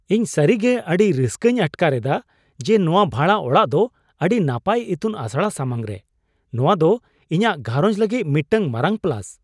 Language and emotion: Santali, surprised